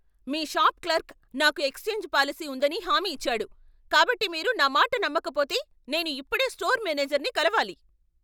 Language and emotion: Telugu, angry